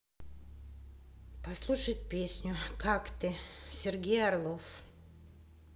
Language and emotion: Russian, neutral